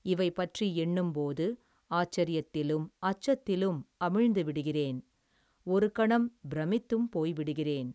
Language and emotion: Tamil, neutral